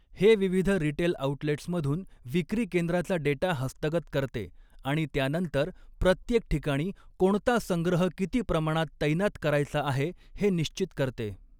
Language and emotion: Marathi, neutral